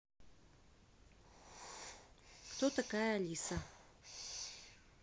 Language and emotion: Russian, neutral